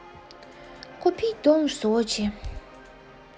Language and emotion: Russian, sad